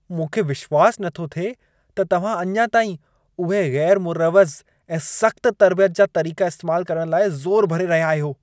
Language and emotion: Sindhi, disgusted